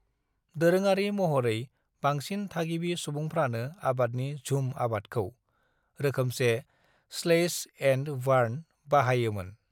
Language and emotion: Bodo, neutral